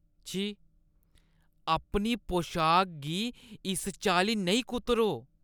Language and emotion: Dogri, disgusted